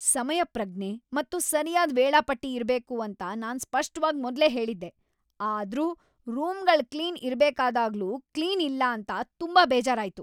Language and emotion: Kannada, angry